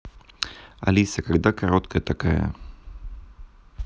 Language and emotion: Russian, neutral